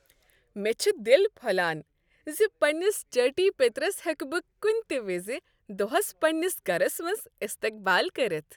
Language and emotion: Kashmiri, happy